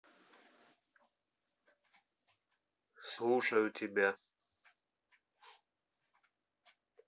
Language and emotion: Russian, neutral